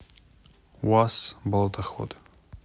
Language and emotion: Russian, neutral